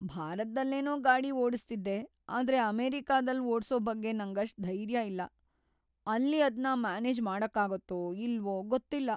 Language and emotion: Kannada, fearful